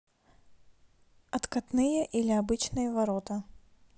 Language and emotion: Russian, neutral